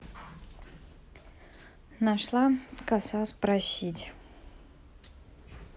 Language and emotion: Russian, neutral